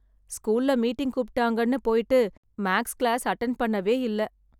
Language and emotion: Tamil, sad